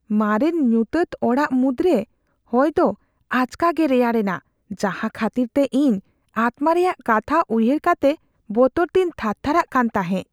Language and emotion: Santali, fearful